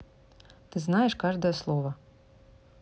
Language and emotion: Russian, neutral